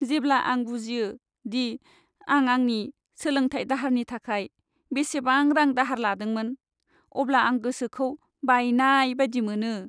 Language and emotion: Bodo, sad